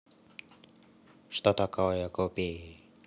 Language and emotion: Russian, neutral